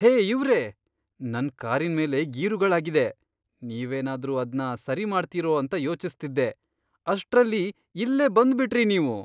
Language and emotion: Kannada, surprised